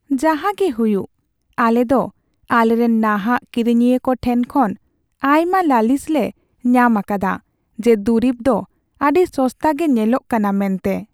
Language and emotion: Santali, sad